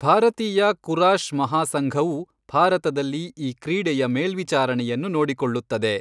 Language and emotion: Kannada, neutral